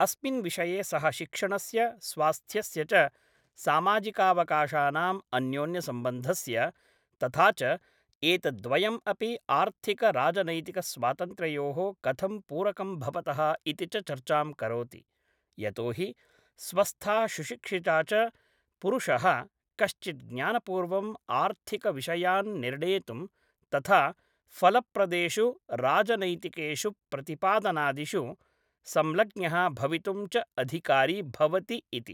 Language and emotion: Sanskrit, neutral